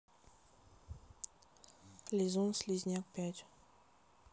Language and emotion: Russian, neutral